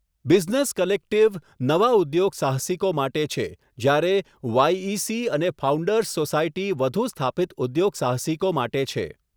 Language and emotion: Gujarati, neutral